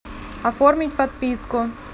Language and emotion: Russian, neutral